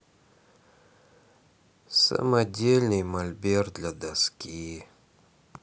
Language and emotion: Russian, sad